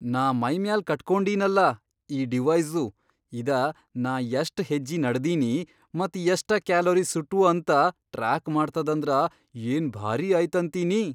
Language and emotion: Kannada, surprised